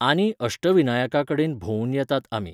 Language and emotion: Goan Konkani, neutral